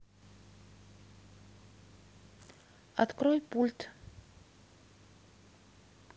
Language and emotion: Russian, neutral